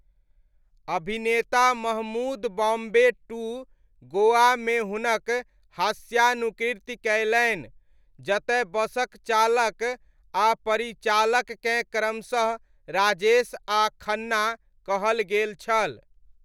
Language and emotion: Maithili, neutral